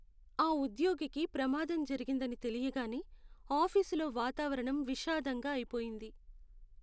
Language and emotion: Telugu, sad